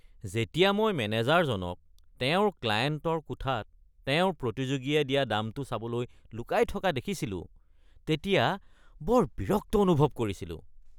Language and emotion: Assamese, disgusted